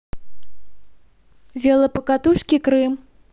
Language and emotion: Russian, positive